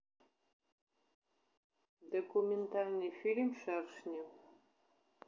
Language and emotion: Russian, neutral